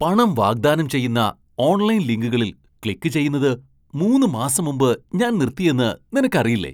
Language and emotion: Malayalam, surprised